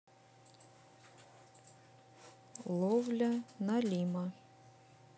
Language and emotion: Russian, neutral